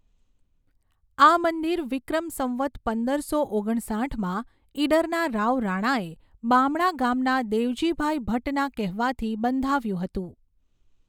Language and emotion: Gujarati, neutral